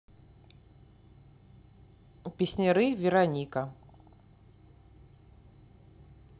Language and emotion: Russian, neutral